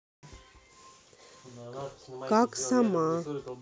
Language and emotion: Russian, neutral